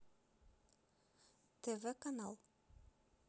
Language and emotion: Russian, neutral